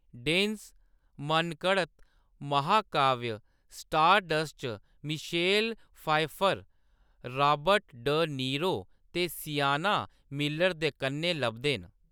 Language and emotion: Dogri, neutral